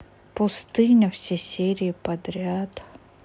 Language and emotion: Russian, sad